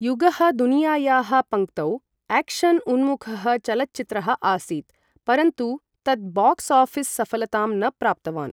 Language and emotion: Sanskrit, neutral